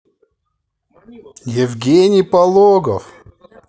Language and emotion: Russian, positive